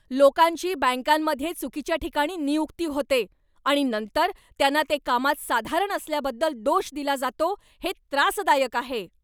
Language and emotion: Marathi, angry